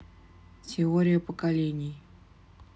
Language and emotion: Russian, neutral